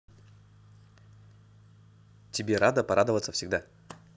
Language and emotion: Russian, neutral